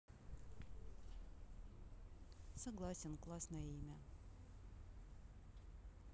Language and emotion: Russian, neutral